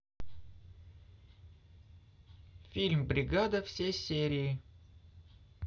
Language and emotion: Russian, neutral